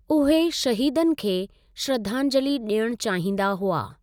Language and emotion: Sindhi, neutral